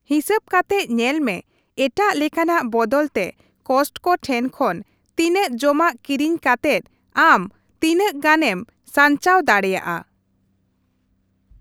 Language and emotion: Santali, neutral